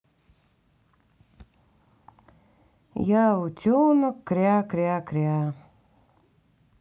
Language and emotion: Russian, sad